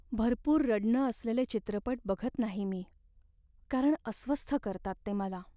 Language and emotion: Marathi, sad